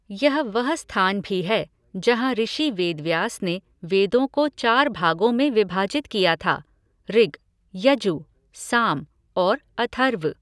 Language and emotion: Hindi, neutral